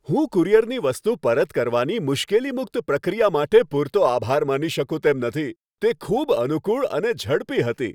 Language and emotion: Gujarati, happy